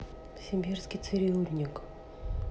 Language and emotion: Russian, sad